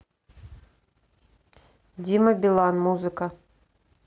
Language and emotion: Russian, neutral